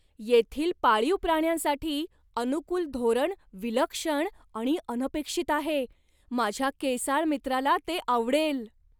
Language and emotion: Marathi, surprised